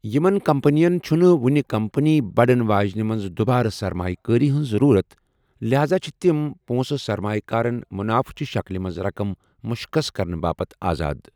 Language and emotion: Kashmiri, neutral